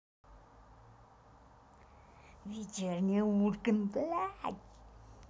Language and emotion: Russian, angry